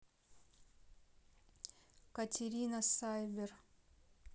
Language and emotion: Russian, neutral